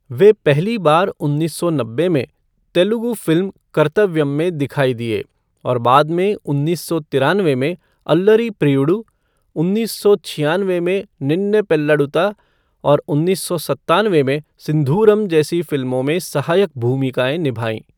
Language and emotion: Hindi, neutral